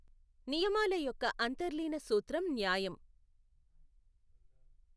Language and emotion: Telugu, neutral